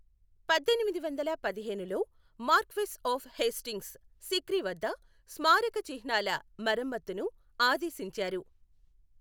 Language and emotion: Telugu, neutral